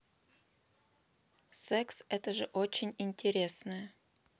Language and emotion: Russian, neutral